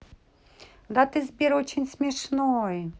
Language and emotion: Russian, neutral